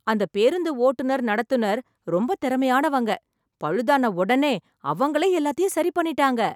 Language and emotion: Tamil, happy